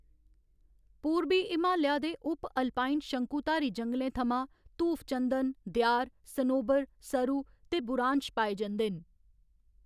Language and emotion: Dogri, neutral